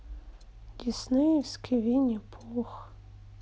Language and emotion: Russian, sad